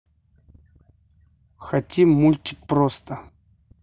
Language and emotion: Russian, neutral